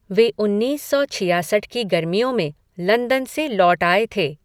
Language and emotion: Hindi, neutral